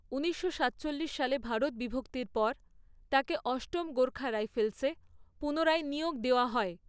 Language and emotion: Bengali, neutral